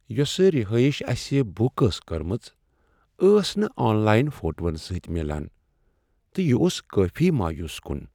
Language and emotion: Kashmiri, sad